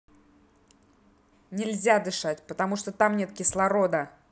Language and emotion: Russian, angry